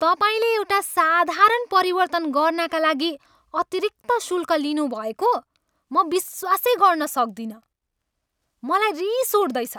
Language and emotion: Nepali, angry